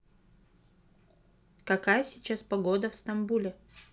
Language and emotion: Russian, neutral